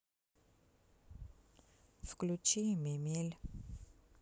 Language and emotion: Russian, sad